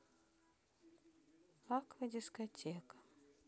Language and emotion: Russian, sad